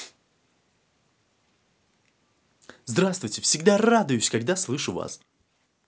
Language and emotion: Russian, positive